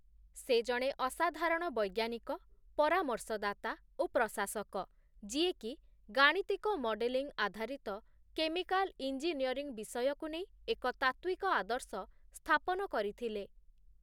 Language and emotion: Odia, neutral